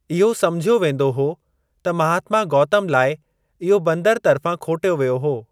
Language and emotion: Sindhi, neutral